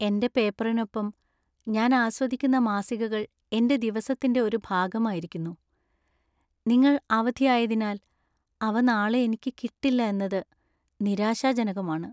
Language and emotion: Malayalam, sad